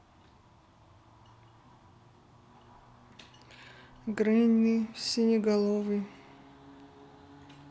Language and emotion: Russian, neutral